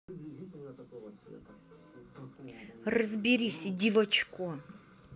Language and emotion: Russian, angry